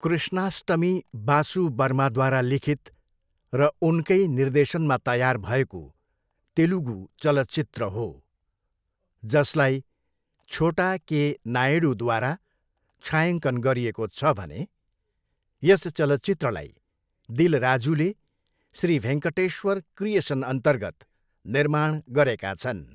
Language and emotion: Nepali, neutral